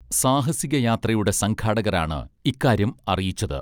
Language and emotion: Malayalam, neutral